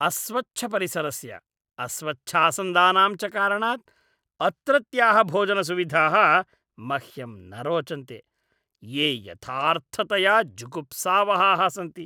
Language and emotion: Sanskrit, disgusted